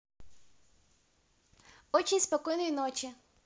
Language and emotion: Russian, positive